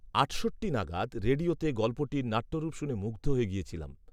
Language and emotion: Bengali, neutral